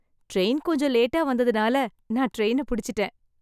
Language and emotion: Tamil, happy